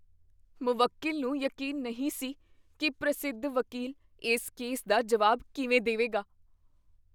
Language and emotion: Punjabi, fearful